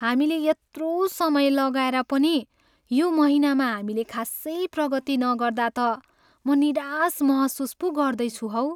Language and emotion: Nepali, sad